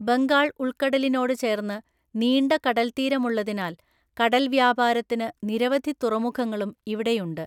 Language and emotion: Malayalam, neutral